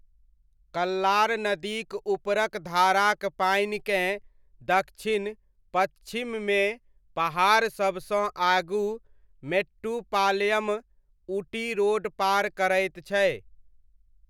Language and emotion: Maithili, neutral